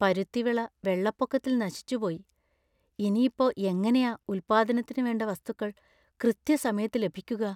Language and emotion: Malayalam, fearful